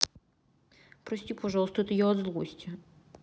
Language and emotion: Russian, sad